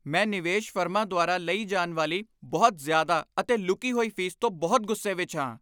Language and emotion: Punjabi, angry